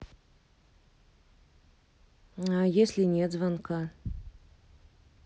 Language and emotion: Russian, neutral